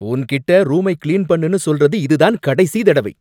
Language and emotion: Tamil, angry